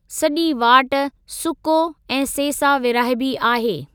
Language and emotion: Sindhi, neutral